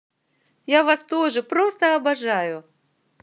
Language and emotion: Russian, positive